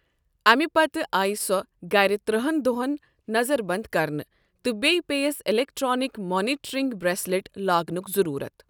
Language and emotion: Kashmiri, neutral